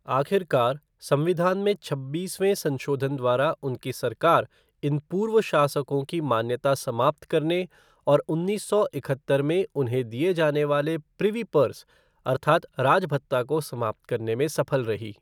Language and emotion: Hindi, neutral